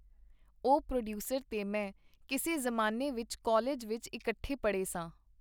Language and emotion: Punjabi, neutral